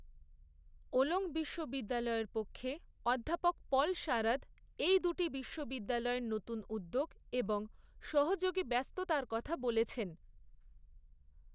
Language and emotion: Bengali, neutral